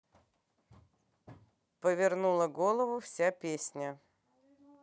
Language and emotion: Russian, neutral